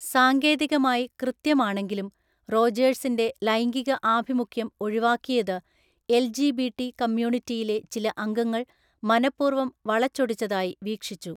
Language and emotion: Malayalam, neutral